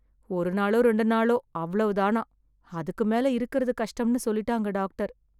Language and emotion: Tamil, sad